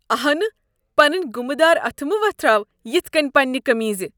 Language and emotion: Kashmiri, disgusted